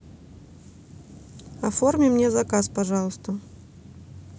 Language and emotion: Russian, neutral